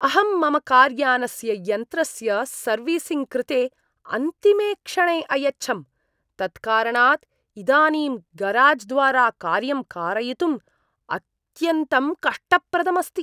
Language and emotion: Sanskrit, disgusted